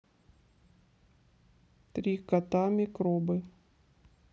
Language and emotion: Russian, neutral